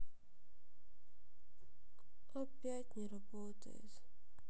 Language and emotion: Russian, sad